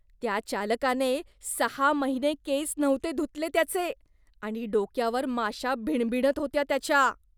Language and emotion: Marathi, disgusted